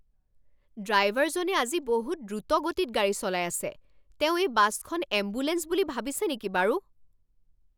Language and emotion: Assamese, angry